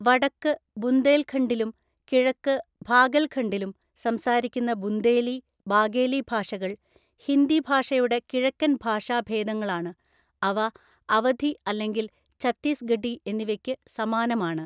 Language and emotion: Malayalam, neutral